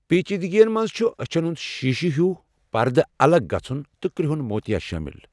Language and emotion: Kashmiri, neutral